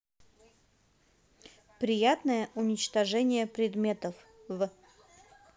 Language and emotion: Russian, neutral